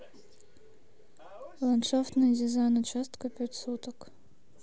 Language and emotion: Russian, neutral